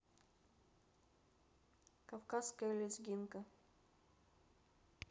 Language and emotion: Russian, neutral